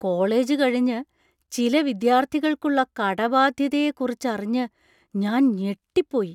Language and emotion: Malayalam, surprised